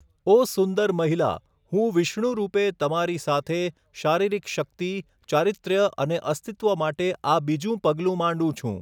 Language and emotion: Gujarati, neutral